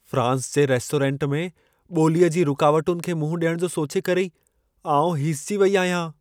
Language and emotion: Sindhi, fearful